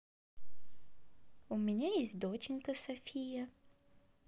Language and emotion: Russian, positive